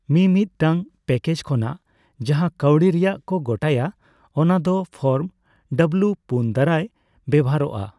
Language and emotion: Santali, neutral